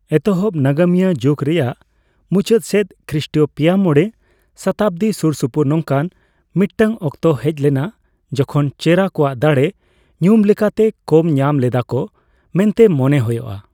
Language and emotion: Santali, neutral